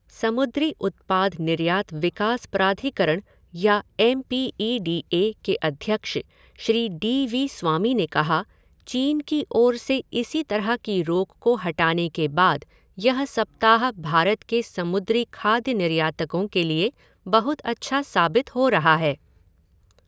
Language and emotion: Hindi, neutral